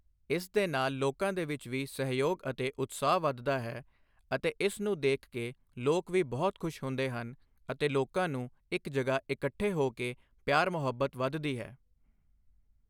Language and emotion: Punjabi, neutral